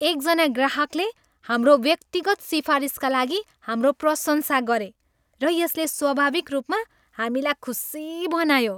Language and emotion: Nepali, happy